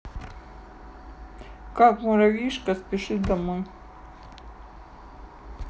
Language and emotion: Russian, neutral